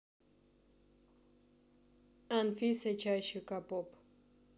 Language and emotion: Russian, neutral